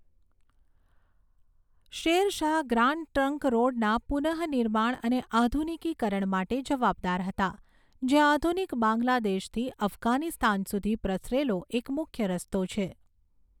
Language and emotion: Gujarati, neutral